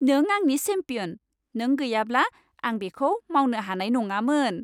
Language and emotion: Bodo, happy